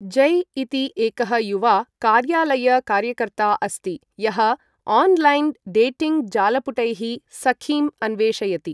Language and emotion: Sanskrit, neutral